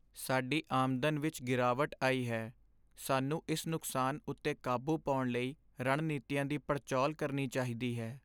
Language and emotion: Punjabi, sad